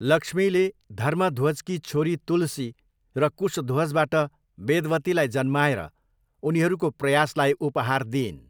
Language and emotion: Nepali, neutral